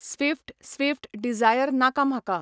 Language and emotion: Goan Konkani, neutral